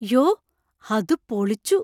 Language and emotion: Malayalam, surprised